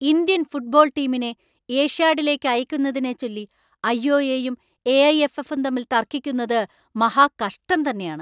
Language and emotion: Malayalam, angry